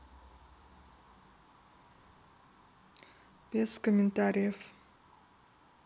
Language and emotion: Russian, neutral